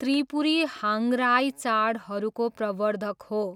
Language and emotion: Nepali, neutral